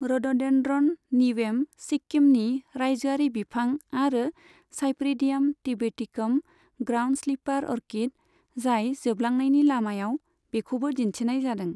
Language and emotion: Bodo, neutral